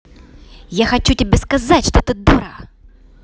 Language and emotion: Russian, angry